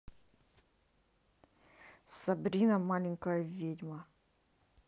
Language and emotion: Russian, angry